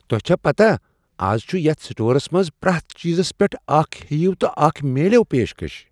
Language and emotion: Kashmiri, surprised